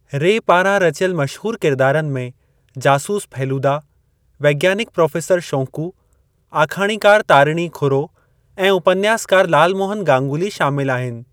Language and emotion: Sindhi, neutral